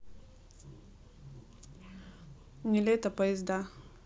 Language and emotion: Russian, neutral